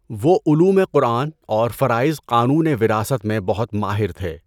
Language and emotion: Urdu, neutral